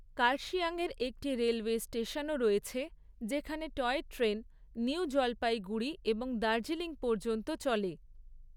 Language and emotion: Bengali, neutral